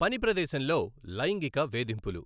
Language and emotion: Telugu, neutral